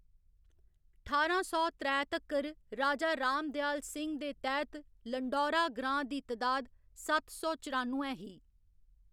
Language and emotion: Dogri, neutral